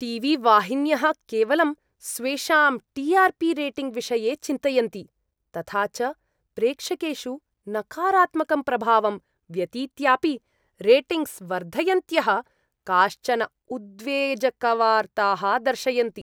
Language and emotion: Sanskrit, disgusted